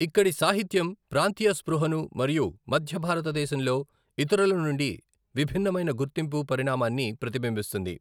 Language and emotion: Telugu, neutral